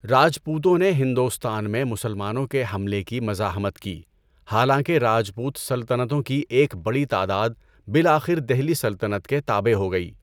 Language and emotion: Urdu, neutral